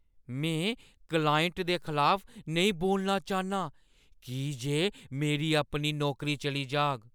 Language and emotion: Dogri, fearful